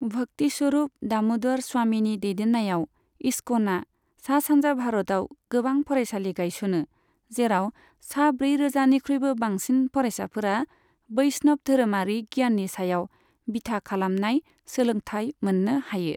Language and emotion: Bodo, neutral